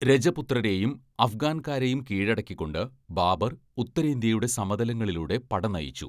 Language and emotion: Malayalam, neutral